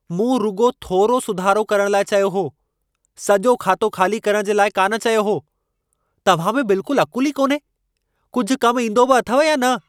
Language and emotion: Sindhi, angry